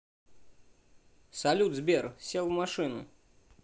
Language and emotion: Russian, neutral